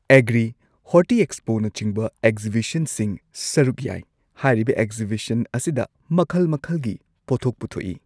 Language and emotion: Manipuri, neutral